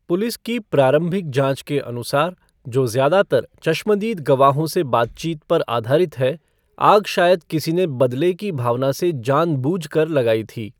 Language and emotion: Hindi, neutral